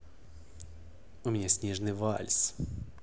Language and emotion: Russian, positive